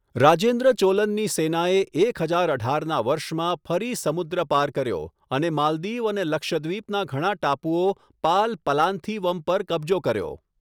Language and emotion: Gujarati, neutral